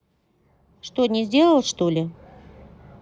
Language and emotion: Russian, neutral